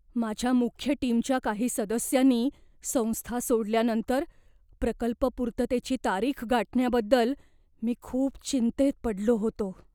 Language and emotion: Marathi, fearful